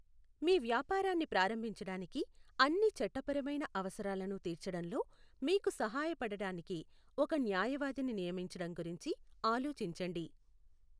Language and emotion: Telugu, neutral